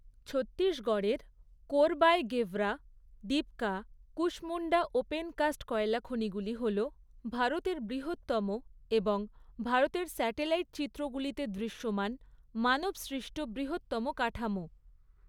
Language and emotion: Bengali, neutral